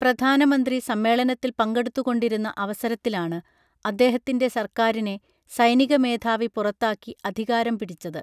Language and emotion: Malayalam, neutral